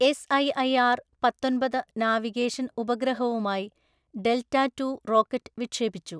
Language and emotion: Malayalam, neutral